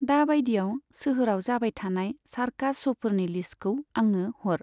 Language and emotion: Bodo, neutral